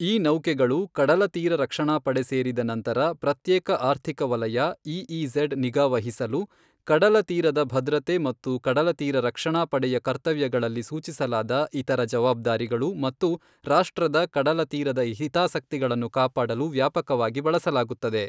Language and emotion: Kannada, neutral